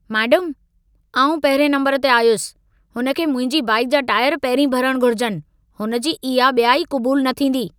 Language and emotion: Sindhi, angry